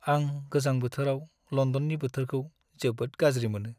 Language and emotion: Bodo, sad